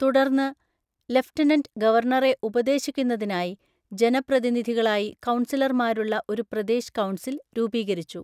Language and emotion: Malayalam, neutral